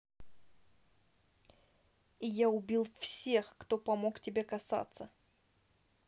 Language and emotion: Russian, neutral